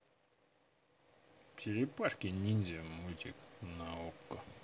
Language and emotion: Russian, positive